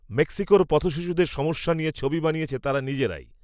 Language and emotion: Bengali, neutral